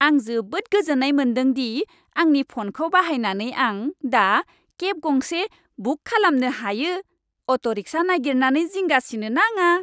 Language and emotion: Bodo, happy